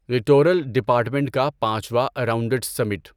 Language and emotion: Urdu, neutral